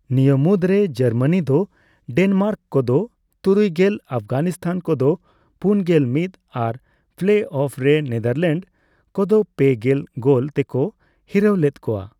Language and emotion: Santali, neutral